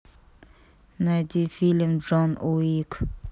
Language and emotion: Russian, neutral